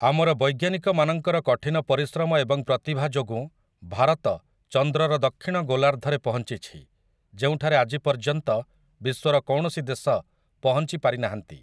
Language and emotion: Odia, neutral